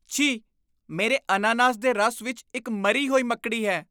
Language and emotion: Punjabi, disgusted